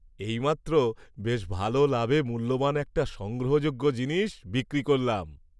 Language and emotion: Bengali, happy